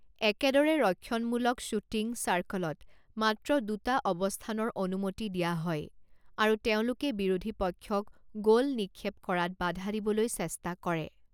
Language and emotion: Assamese, neutral